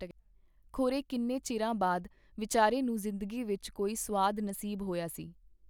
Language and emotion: Punjabi, neutral